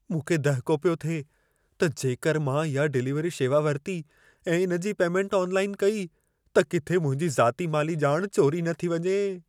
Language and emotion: Sindhi, fearful